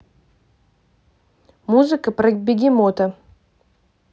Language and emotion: Russian, neutral